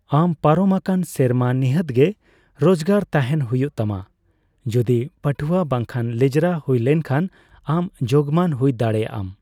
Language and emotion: Santali, neutral